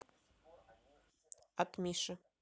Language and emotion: Russian, neutral